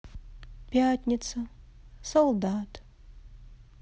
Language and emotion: Russian, sad